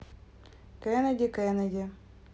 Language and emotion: Russian, neutral